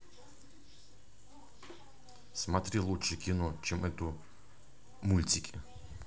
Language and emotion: Russian, neutral